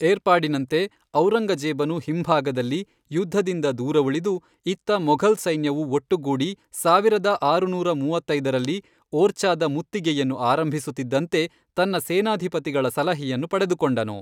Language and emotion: Kannada, neutral